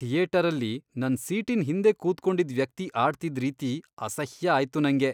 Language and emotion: Kannada, disgusted